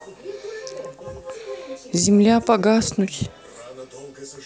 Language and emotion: Russian, sad